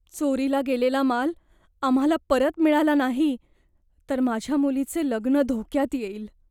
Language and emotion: Marathi, fearful